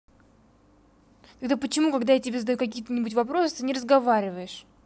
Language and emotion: Russian, angry